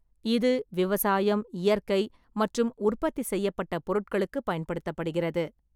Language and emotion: Tamil, neutral